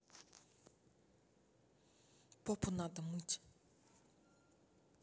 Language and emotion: Russian, neutral